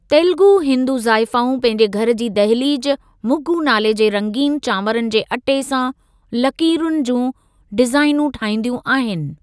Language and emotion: Sindhi, neutral